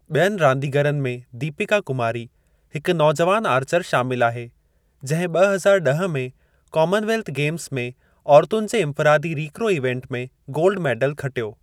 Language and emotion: Sindhi, neutral